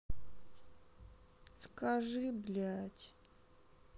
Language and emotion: Russian, sad